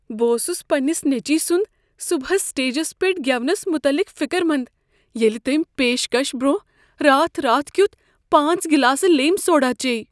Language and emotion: Kashmiri, fearful